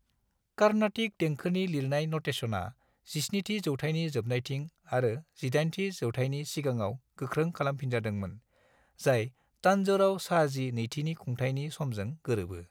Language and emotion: Bodo, neutral